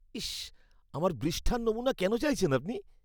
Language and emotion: Bengali, disgusted